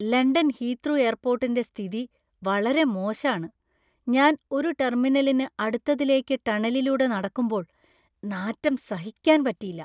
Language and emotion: Malayalam, disgusted